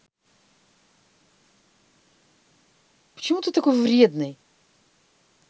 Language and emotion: Russian, angry